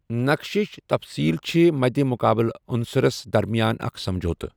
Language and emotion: Kashmiri, neutral